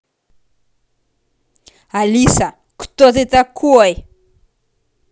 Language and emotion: Russian, angry